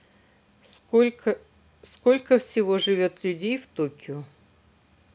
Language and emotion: Russian, neutral